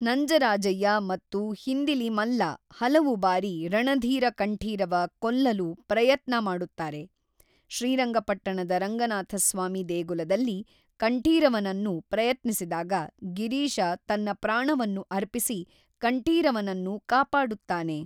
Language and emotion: Kannada, neutral